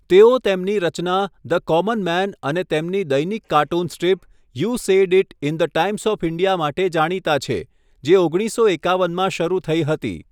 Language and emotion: Gujarati, neutral